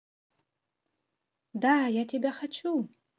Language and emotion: Russian, positive